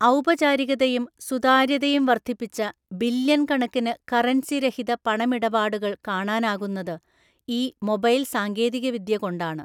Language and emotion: Malayalam, neutral